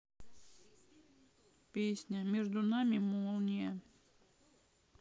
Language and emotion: Russian, sad